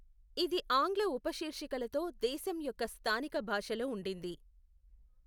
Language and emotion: Telugu, neutral